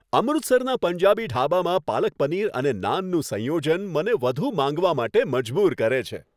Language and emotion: Gujarati, happy